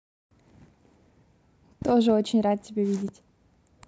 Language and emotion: Russian, positive